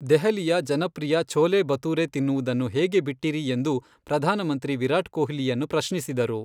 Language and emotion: Kannada, neutral